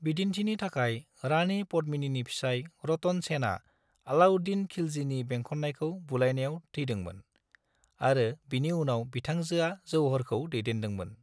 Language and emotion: Bodo, neutral